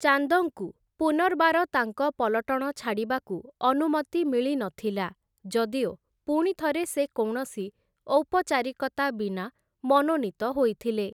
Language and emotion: Odia, neutral